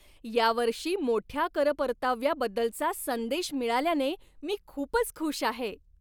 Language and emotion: Marathi, happy